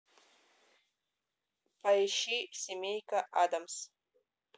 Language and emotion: Russian, neutral